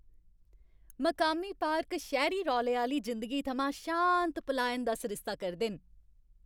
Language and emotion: Dogri, happy